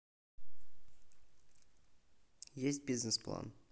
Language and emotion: Russian, neutral